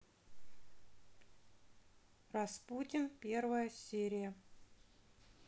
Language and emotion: Russian, neutral